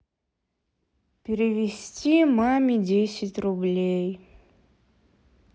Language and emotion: Russian, sad